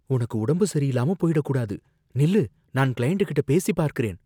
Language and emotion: Tamil, fearful